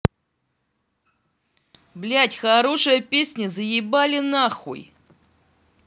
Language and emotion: Russian, angry